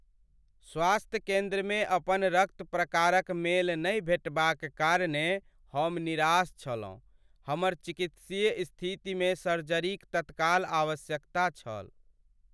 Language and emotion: Maithili, sad